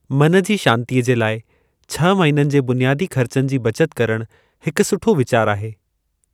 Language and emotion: Sindhi, neutral